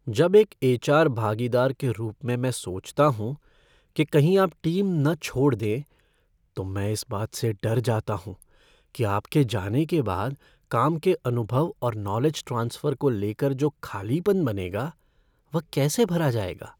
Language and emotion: Hindi, fearful